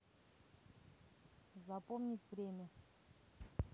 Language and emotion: Russian, neutral